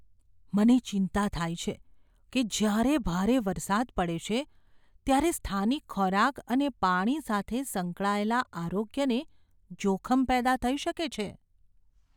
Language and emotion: Gujarati, fearful